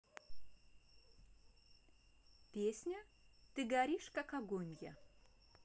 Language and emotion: Russian, neutral